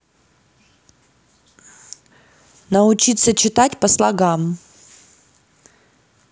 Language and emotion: Russian, neutral